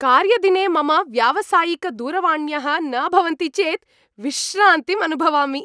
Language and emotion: Sanskrit, happy